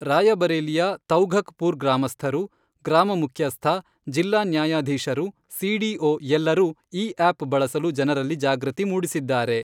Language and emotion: Kannada, neutral